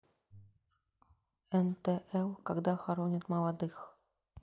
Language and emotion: Russian, neutral